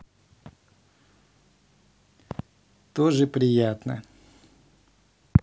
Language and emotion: Russian, positive